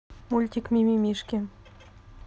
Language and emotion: Russian, neutral